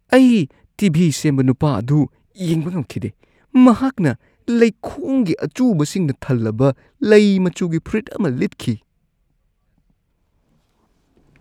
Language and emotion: Manipuri, disgusted